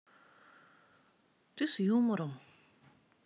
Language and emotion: Russian, sad